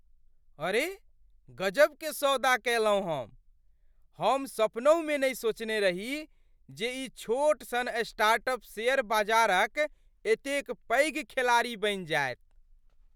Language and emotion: Maithili, surprised